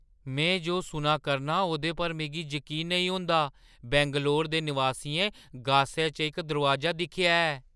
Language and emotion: Dogri, surprised